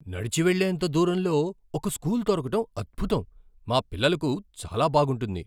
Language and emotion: Telugu, surprised